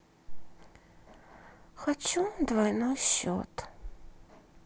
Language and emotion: Russian, sad